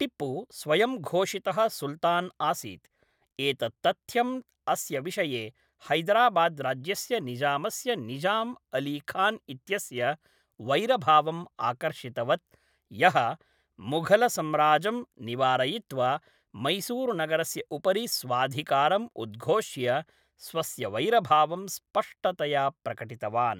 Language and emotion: Sanskrit, neutral